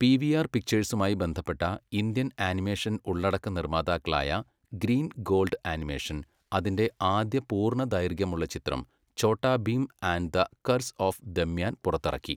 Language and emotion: Malayalam, neutral